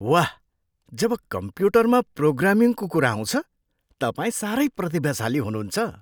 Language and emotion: Nepali, surprised